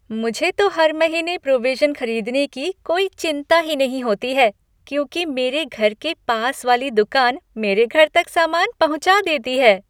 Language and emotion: Hindi, happy